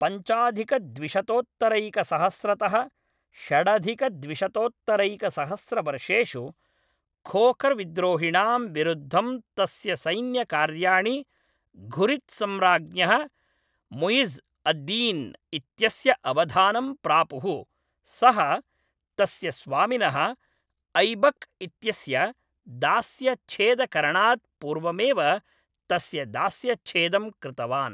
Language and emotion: Sanskrit, neutral